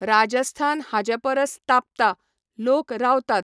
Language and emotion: Goan Konkani, neutral